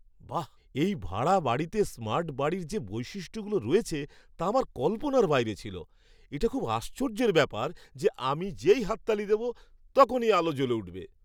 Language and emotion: Bengali, surprised